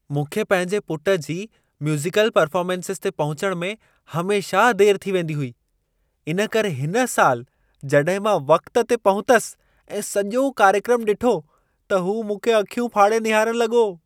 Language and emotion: Sindhi, surprised